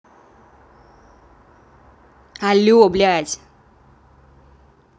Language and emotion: Russian, angry